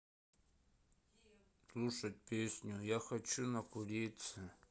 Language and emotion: Russian, sad